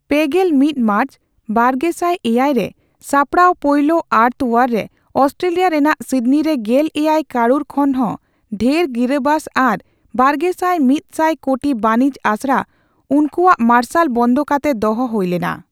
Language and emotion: Santali, neutral